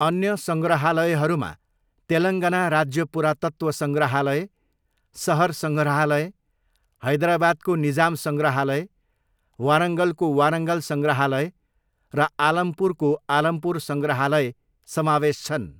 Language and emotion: Nepali, neutral